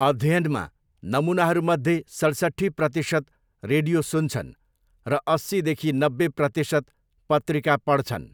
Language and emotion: Nepali, neutral